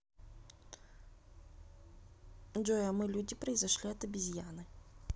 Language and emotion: Russian, neutral